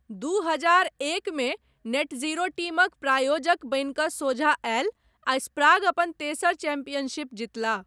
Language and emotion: Maithili, neutral